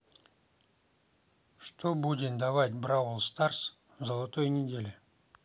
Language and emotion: Russian, neutral